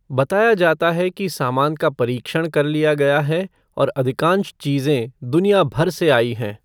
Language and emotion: Hindi, neutral